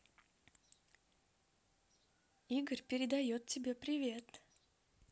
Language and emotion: Russian, positive